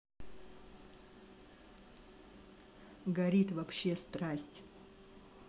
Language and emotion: Russian, neutral